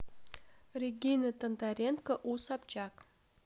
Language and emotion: Russian, neutral